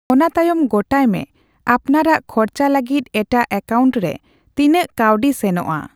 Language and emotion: Santali, neutral